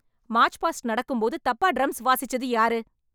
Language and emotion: Tamil, angry